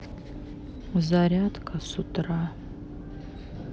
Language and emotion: Russian, sad